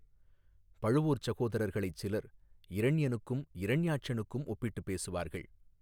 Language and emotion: Tamil, neutral